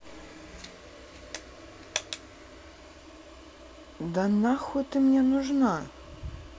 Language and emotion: Russian, angry